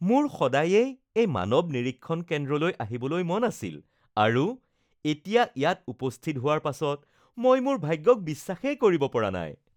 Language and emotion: Assamese, happy